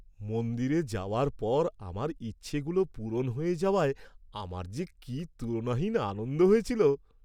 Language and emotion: Bengali, happy